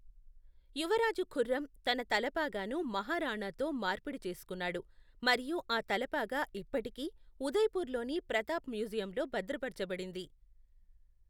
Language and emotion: Telugu, neutral